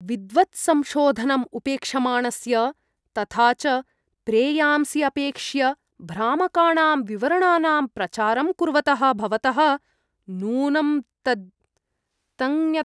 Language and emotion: Sanskrit, disgusted